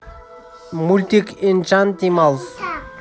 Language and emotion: Russian, neutral